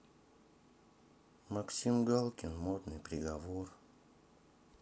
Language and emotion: Russian, sad